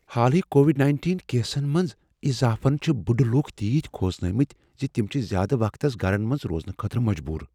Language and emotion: Kashmiri, fearful